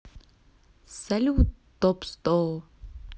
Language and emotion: Russian, positive